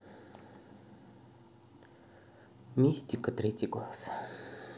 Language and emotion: Russian, neutral